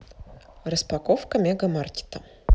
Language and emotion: Russian, neutral